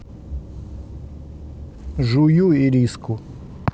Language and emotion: Russian, neutral